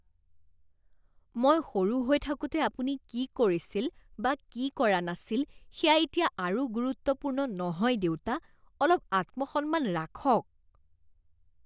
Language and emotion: Assamese, disgusted